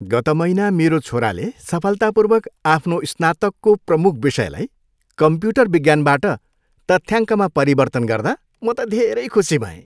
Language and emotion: Nepali, happy